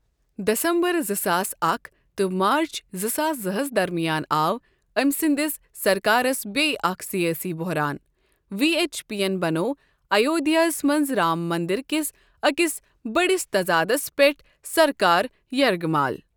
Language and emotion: Kashmiri, neutral